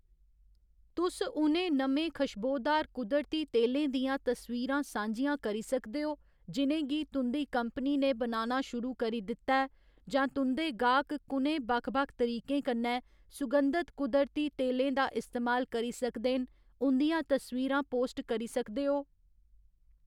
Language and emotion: Dogri, neutral